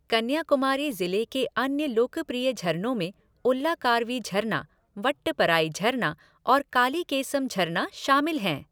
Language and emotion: Hindi, neutral